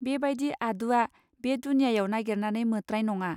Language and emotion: Bodo, neutral